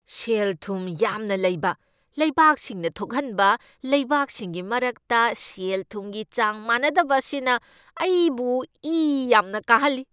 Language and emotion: Manipuri, angry